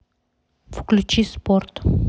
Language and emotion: Russian, neutral